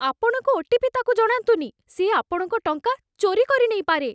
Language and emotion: Odia, fearful